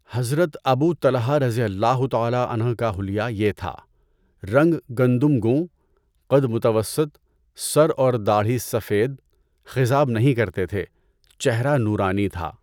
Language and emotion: Urdu, neutral